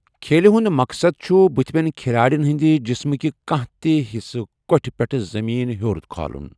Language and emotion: Kashmiri, neutral